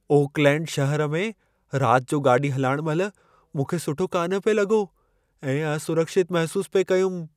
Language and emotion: Sindhi, fearful